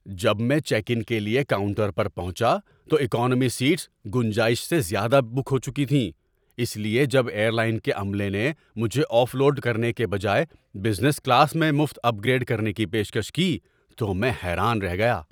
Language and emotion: Urdu, surprised